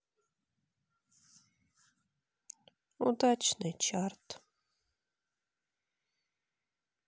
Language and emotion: Russian, sad